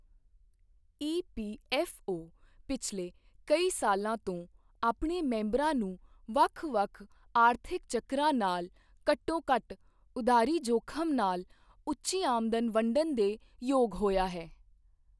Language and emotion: Punjabi, neutral